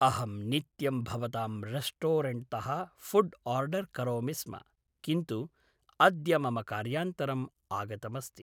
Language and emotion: Sanskrit, neutral